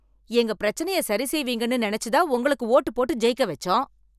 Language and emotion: Tamil, angry